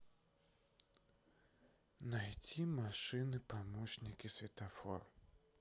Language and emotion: Russian, sad